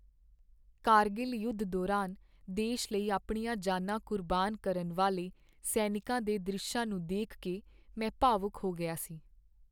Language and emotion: Punjabi, sad